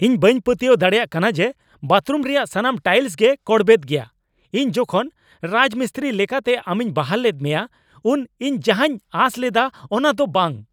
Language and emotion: Santali, angry